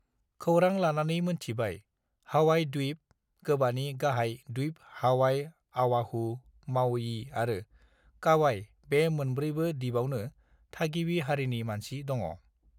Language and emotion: Bodo, neutral